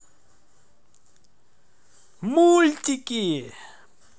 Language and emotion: Russian, positive